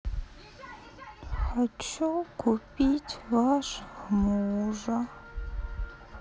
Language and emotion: Russian, sad